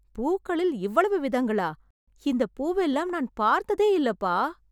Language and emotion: Tamil, surprised